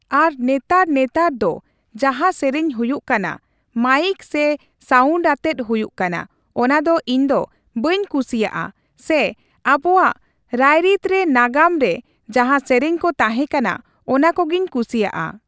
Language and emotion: Santali, neutral